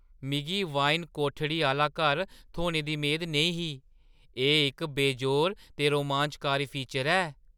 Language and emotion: Dogri, surprised